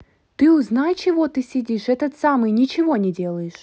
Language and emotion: Russian, neutral